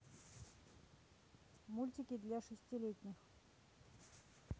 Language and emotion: Russian, neutral